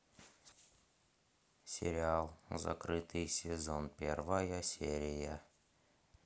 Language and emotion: Russian, neutral